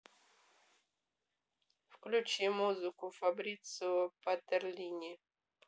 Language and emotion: Russian, neutral